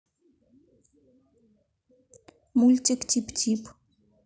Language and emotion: Russian, neutral